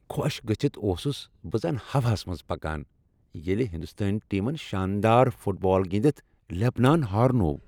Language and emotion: Kashmiri, happy